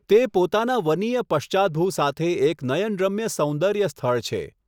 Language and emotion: Gujarati, neutral